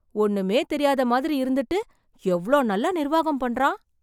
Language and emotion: Tamil, surprised